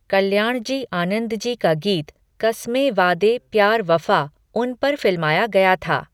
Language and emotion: Hindi, neutral